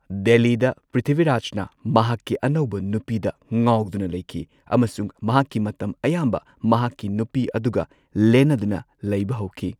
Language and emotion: Manipuri, neutral